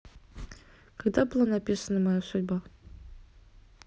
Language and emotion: Russian, neutral